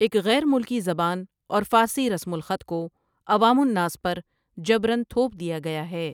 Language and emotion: Urdu, neutral